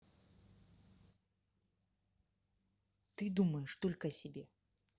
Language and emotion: Russian, angry